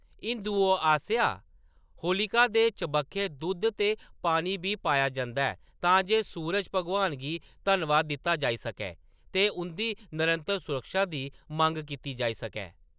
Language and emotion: Dogri, neutral